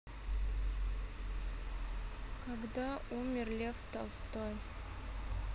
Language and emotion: Russian, sad